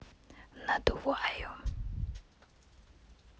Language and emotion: Russian, neutral